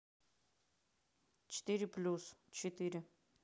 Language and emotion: Russian, neutral